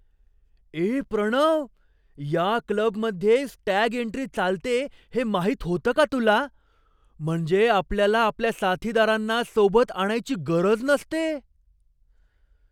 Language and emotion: Marathi, surprised